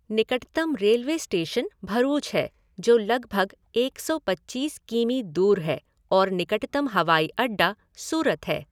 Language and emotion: Hindi, neutral